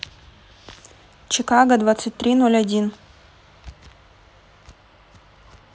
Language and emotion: Russian, neutral